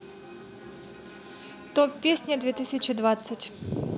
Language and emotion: Russian, positive